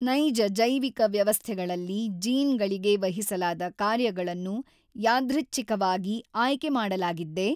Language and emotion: Kannada, neutral